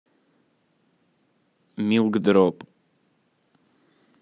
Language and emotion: Russian, neutral